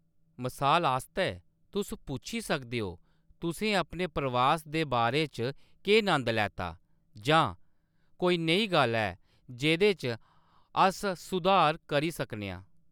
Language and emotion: Dogri, neutral